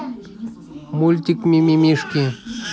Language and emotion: Russian, neutral